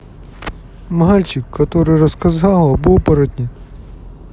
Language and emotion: Russian, sad